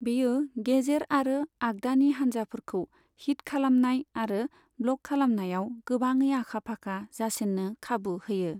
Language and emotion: Bodo, neutral